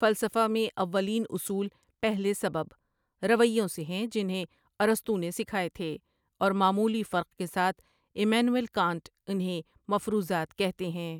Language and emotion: Urdu, neutral